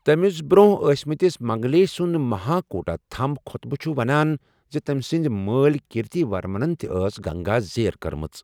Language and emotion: Kashmiri, neutral